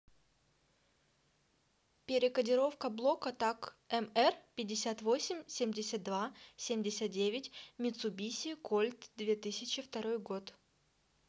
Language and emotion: Russian, neutral